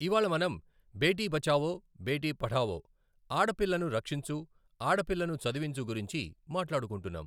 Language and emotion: Telugu, neutral